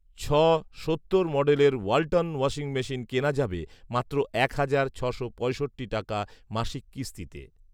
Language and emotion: Bengali, neutral